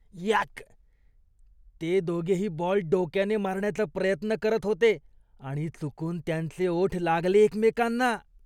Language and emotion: Marathi, disgusted